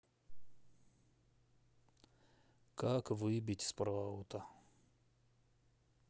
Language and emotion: Russian, sad